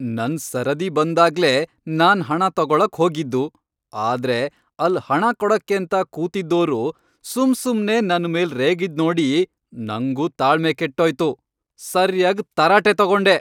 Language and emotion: Kannada, angry